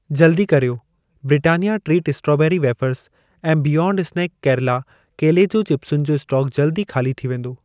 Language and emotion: Sindhi, neutral